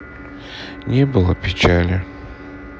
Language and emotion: Russian, sad